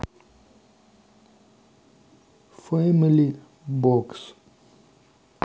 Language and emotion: Russian, neutral